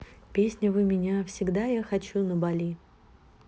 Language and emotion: Russian, neutral